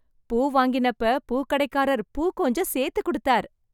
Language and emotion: Tamil, happy